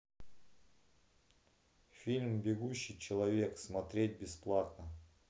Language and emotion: Russian, neutral